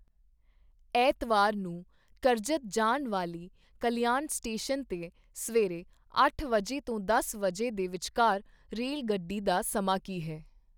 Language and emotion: Punjabi, neutral